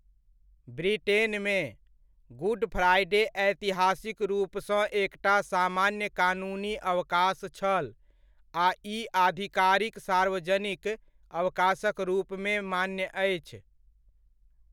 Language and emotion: Maithili, neutral